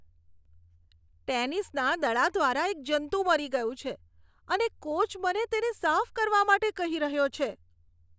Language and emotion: Gujarati, disgusted